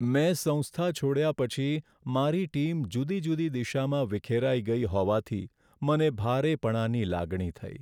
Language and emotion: Gujarati, sad